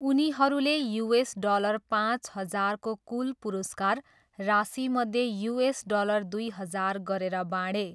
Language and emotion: Nepali, neutral